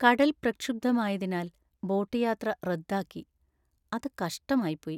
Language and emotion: Malayalam, sad